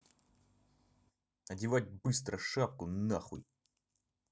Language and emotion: Russian, angry